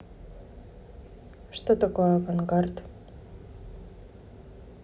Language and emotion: Russian, neutral